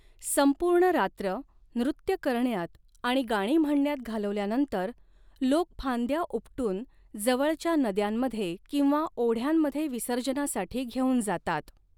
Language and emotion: Marathi, neutral